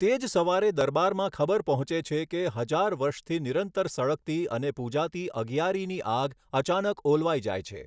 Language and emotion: Gujarati, neutral